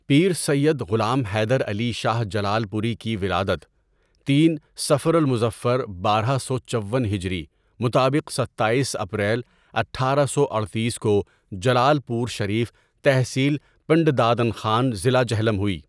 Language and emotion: Urdu, neutral